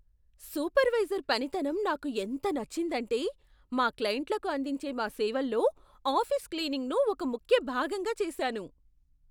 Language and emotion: Telugu, surprised